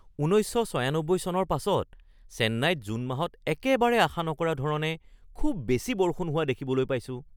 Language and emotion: Assamese, surprised